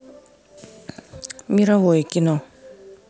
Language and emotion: Russian, neutral